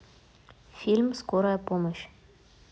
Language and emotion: Russian, neutral